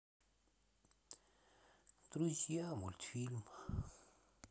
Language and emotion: Russian, sad